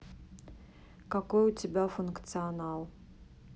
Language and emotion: Russian, neutral